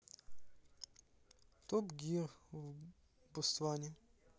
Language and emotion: Russian, neutral